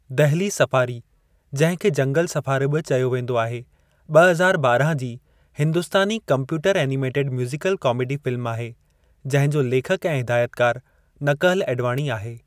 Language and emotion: Sindhi, neutral